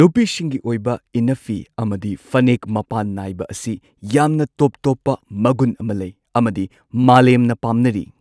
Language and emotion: Manipuri, neutral